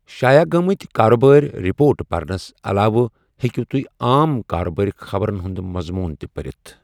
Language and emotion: Kashmiri, neutral